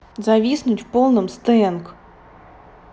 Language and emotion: Russian, neutral